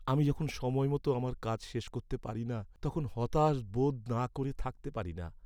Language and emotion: Bengali, sad